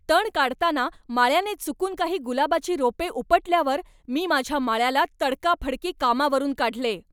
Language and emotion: Marathi, angry